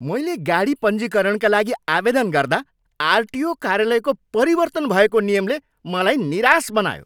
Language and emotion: Nepali, angry